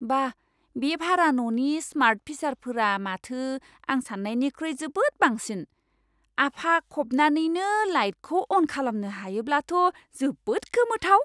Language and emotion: Bodo, surprised